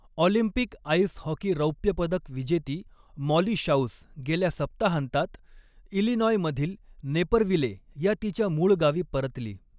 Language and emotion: Marathi, neutral